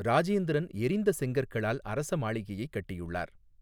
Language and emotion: Tamil, neutral